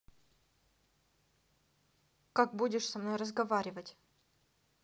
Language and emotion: Russian, neutral